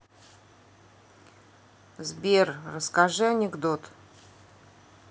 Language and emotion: Russian, neutral